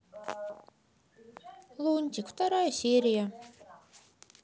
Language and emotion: Russian, sad